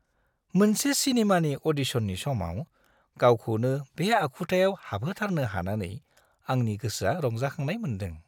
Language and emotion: Bodo, happy